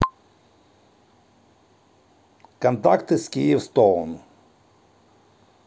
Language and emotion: Russian, neutral